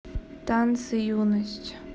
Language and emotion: Russian, neutral